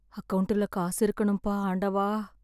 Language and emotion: Tamil, sad